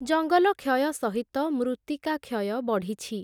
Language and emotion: Odia, neutral